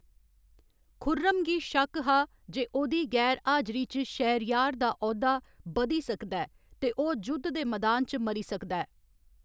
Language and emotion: Dogri, neutral